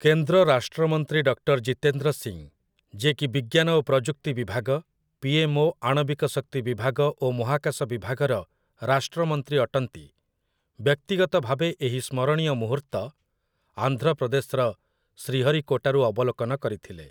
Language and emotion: Odia, neutral